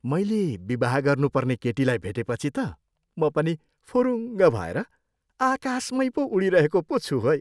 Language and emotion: Nepali, happy